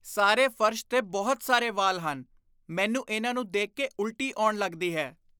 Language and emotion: Punjabi, disgusted